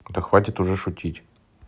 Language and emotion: Russian, angry